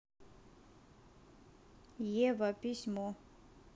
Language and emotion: Russian, neutral